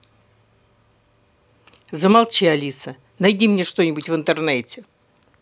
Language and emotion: Russian, angry